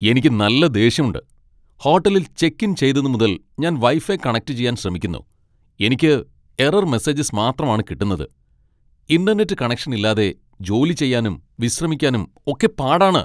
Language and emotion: Malayalam, angry